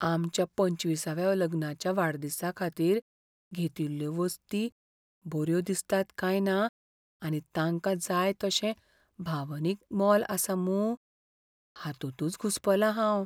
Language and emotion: Goan Konkani, fearful